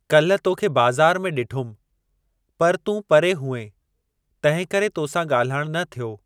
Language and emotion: Sindhi, neutral